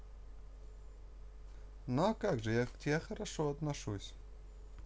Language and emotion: Russian, positive